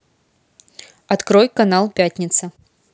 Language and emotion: Russian, neutral